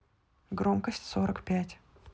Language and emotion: Russian, neutral